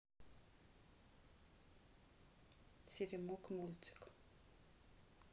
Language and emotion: Russian, neutral